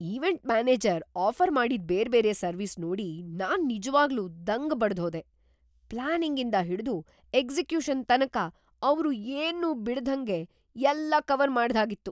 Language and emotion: Kannada, surprised